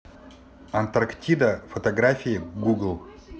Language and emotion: Russian, neutral